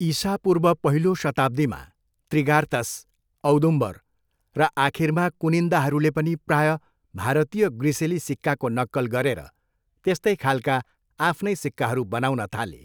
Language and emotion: Nepali, neutral